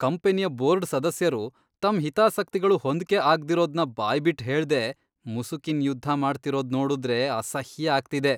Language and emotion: Kannada, disgusted